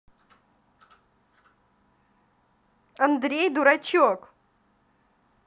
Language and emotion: Russian, neutral